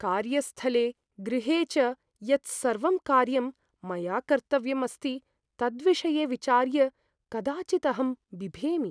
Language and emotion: Sanskrit, fearful